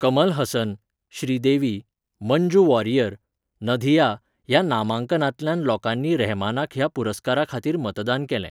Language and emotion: Goan Konkani, neutral